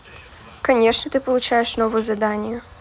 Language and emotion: Russian, neutral